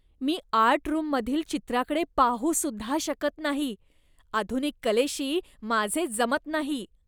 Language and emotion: Marathi, disgusted